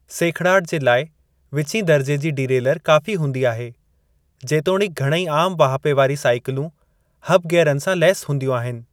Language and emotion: Sindhi, neutral